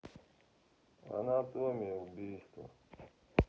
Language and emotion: Russian, neutral